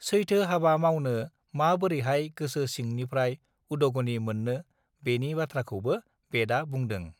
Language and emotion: Bodo, neutral